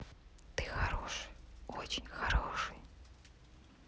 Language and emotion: Russian, neutral